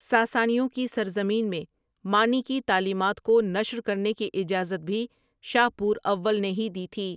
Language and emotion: Urdu, neutral